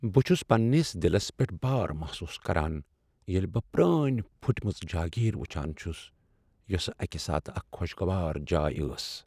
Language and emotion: Kashmiri, sad